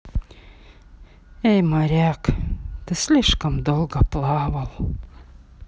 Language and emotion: Russian, sad